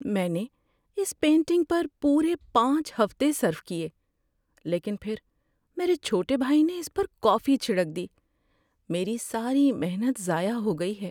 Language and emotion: Urdu, sad